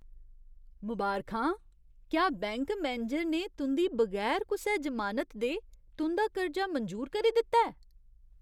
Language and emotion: Dogri, surprised